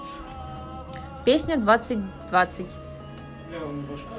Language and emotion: Russian, neutral